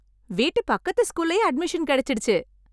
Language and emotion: Tamil, happy